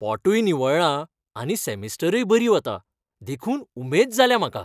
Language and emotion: Goan Konkani, happy